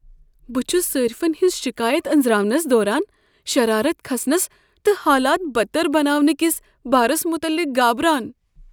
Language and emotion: Kashmiri, fearful